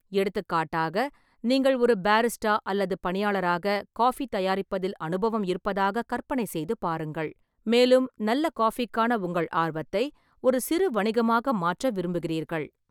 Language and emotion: Tamil, neutral